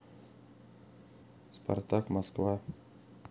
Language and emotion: Russian, neutral